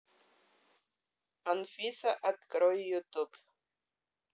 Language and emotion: Russian, neutral